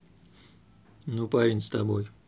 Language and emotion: Russian, neutral